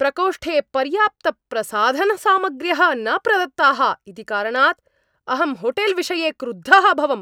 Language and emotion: Sanskrit, angry